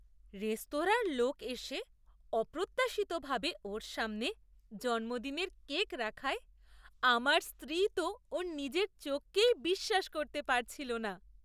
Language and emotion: Bengali, surprised